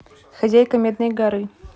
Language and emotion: Russian, neutral